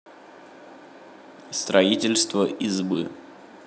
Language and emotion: Russian, neutral